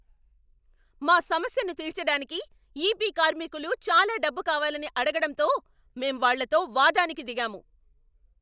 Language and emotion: Telugu, angry